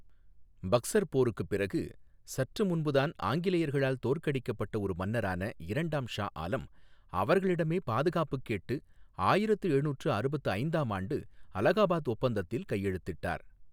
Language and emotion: Tamil, neutral